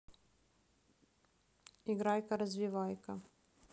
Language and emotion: Russian, neutral